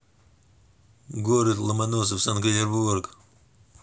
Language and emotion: Russian, neutral